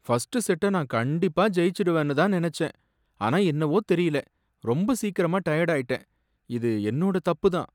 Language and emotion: Tamil, sad